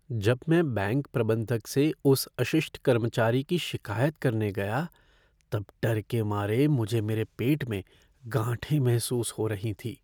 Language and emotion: Hindi, fearful